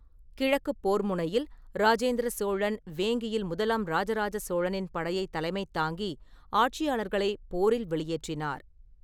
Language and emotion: Tamil, neutral